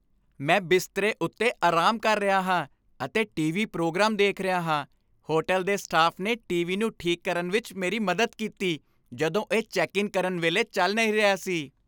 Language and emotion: Punjabi, happy